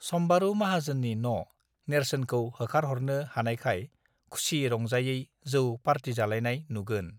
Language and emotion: Bodo, neutral